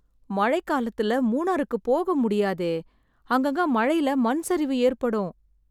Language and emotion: Tamil, sad